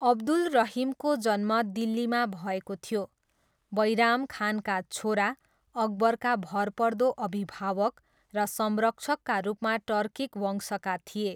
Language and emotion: Nepali, neutral